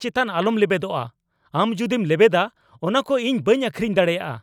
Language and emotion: Santali, angry